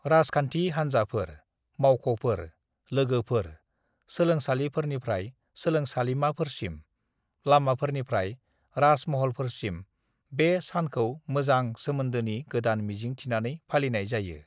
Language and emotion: Bodo, neutral